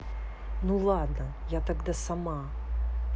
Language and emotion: Russian, neutral